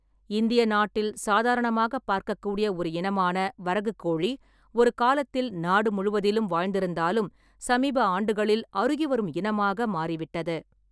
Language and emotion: Tamil, neutral